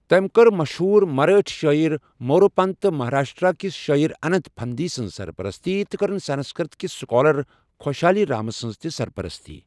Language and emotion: Kashmiri, neutral